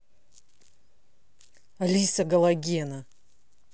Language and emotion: Russian, angry